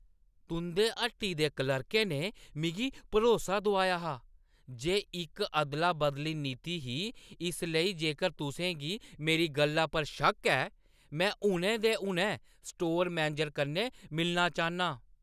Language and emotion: Dogri, angry